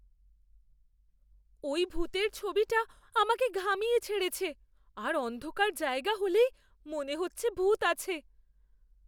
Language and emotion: Bengali, fearful